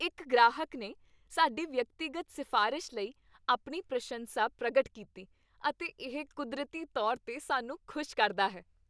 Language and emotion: Punjabi, happy